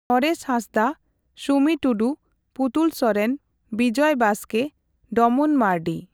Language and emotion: Santali, neutral